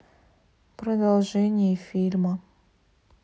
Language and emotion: Russian, neutral